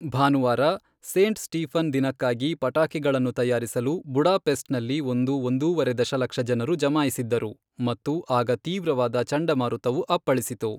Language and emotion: Kannada, neutral